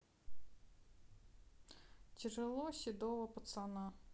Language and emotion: Russian, neutral